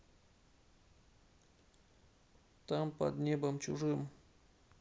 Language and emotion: Russian, sad